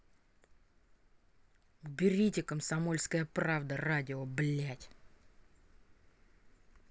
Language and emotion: Russian, angry